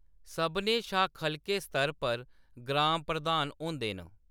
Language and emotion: Dogri, neutral